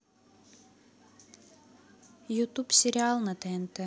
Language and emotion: Russian, neutral